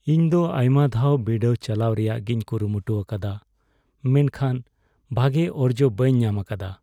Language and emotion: Santali, sad